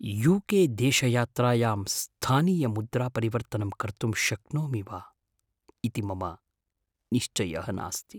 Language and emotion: Sanskrit, fearful